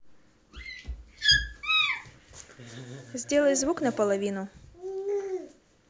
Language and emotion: Russian, neutral